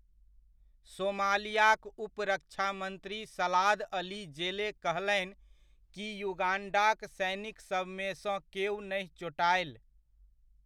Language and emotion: Maithili, neutral